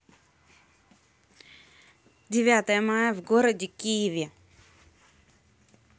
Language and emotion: Russian, neutral